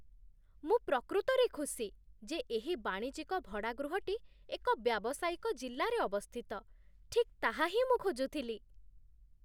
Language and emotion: Odia, surprised